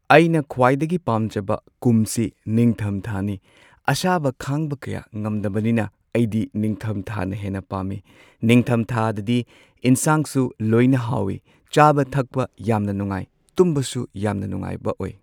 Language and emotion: Manipuri, neutral